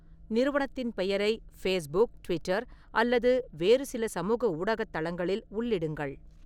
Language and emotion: Tamil, neutral